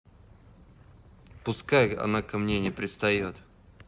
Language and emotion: Russian, neutral